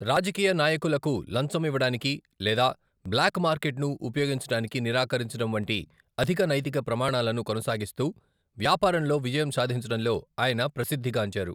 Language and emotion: Telugu, neutral